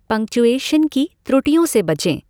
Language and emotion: Hindi, neutral